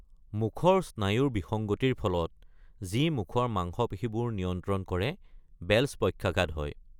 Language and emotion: Assamese, neutral